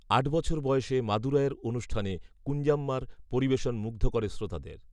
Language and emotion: Bengali, neutral